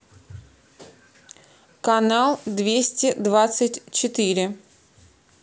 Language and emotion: Russian, neutral